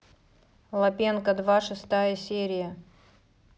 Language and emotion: Russian, neutral